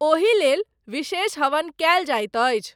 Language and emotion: Maithili, neutral